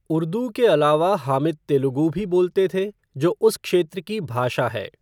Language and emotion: Hindi, neutral